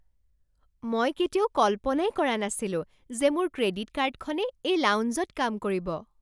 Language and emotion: Assamese, surprised